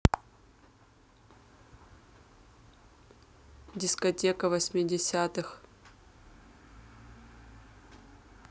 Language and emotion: Russian, neutral